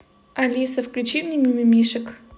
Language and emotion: Russian, neutral